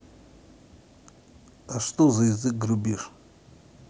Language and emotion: Russian, neutral